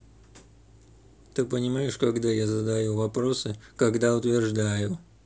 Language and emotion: Russian, neutral